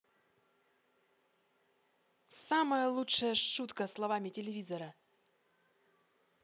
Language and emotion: Russian, positive